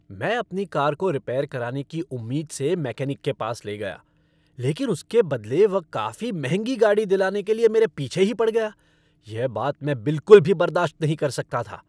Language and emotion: Hindi, angry